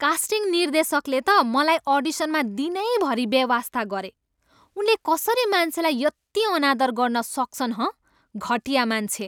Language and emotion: Nepali, angry